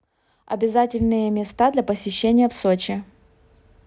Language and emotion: Russian, neutral